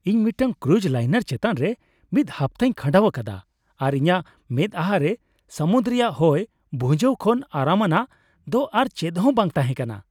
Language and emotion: Santali, happy